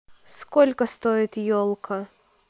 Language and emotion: Russian, neutral